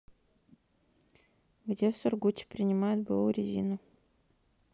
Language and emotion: Russian, neutral